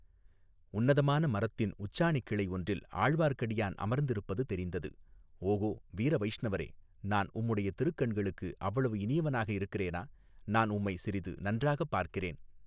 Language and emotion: Tamil, neutral